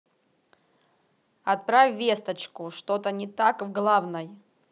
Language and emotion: Russian, neutral